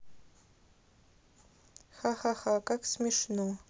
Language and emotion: Russian, neutral